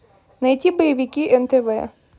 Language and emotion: Russian, neutral